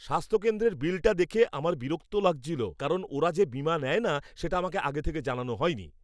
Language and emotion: Bengali, angry